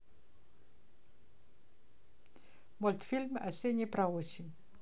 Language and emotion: Russian, neutral